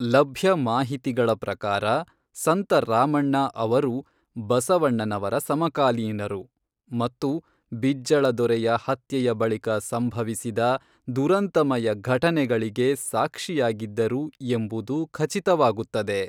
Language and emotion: Kannada, neutral